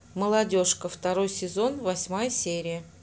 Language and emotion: Russian, neutral